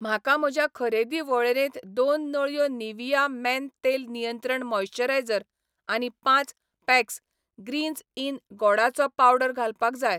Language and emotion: Goan Konkani, neutral